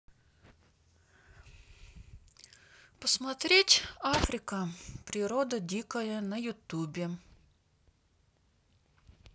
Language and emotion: Russian, neutral